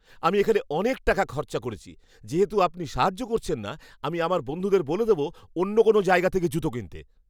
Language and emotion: Bengali, angry